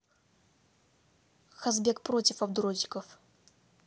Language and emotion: Russian, neutral